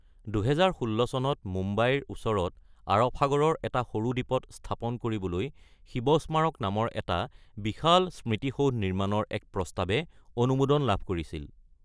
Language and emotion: Assamese, neutral